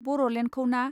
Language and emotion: Bodo, neutral